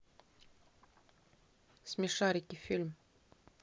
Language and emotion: Russian, neutral